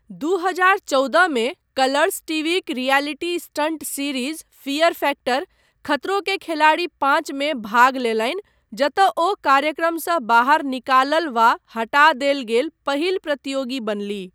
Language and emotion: Maithili, neutral